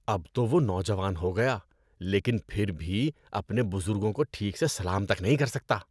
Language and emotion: Urdu, disgusted